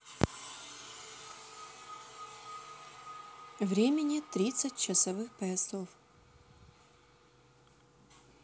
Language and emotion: Russian, neutral